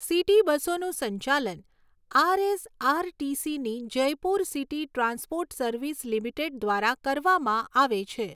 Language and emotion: Gujarati, neutral